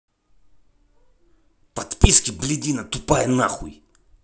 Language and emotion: Russian, angry